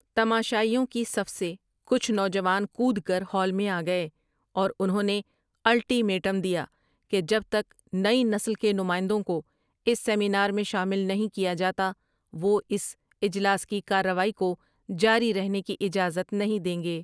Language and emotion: Urdu, neutral